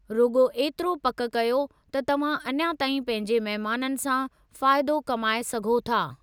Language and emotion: Sindhi, neutral